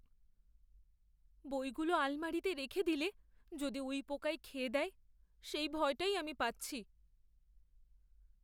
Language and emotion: Bengali, fearful